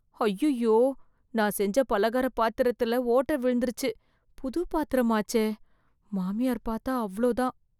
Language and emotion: Tamil, fearful